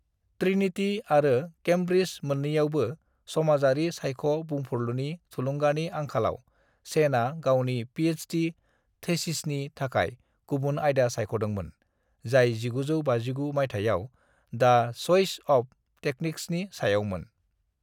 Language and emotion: Bodo, neutral